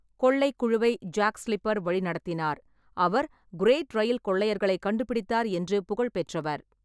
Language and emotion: Tamil, neutral